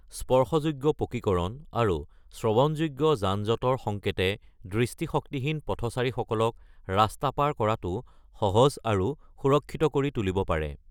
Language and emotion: Assamese, neutral